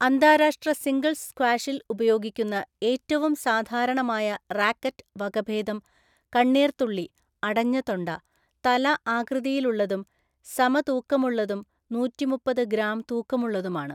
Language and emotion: Malayalam, neutral